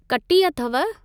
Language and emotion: Sindhi, neutral